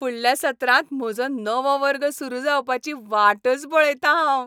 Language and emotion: Goan Konkani, happy